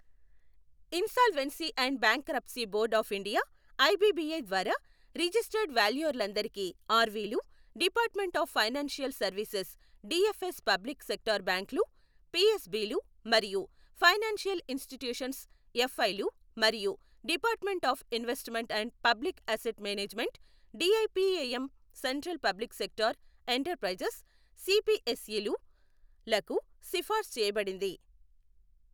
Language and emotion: Telugu, neutral